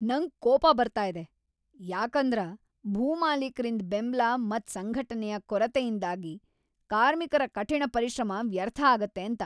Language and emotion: Kannada, angry